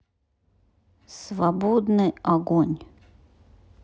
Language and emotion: Russian, neutral